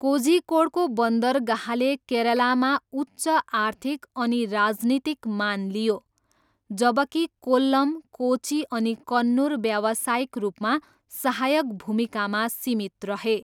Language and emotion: Nepali, neutral